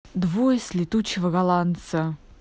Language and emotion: Russian, angry